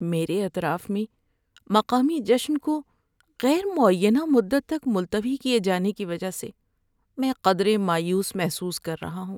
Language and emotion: Urdu, sad